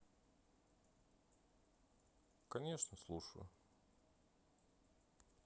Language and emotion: Russian, neutral